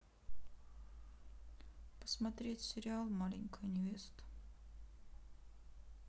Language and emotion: Russian, sad